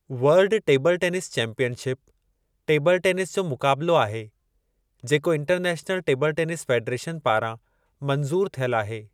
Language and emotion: Sindhi, neutral